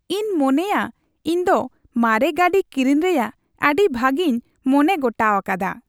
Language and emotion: Santali, happy